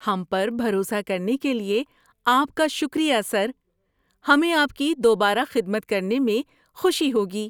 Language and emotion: Urdu, happy